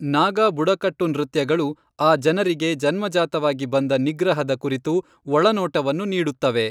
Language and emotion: Kannada, neutral